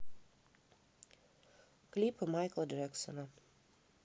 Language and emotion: Russian, neutral